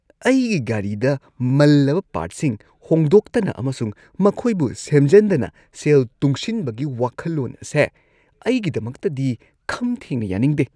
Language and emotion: Manipuri, disgusted